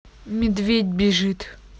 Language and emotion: Russian, neutral